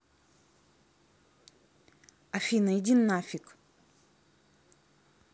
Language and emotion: Russian, angry